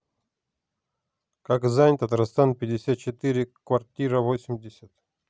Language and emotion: Russian, neutral